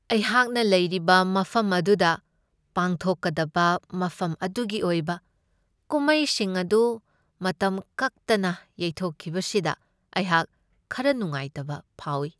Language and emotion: Manipuri, sad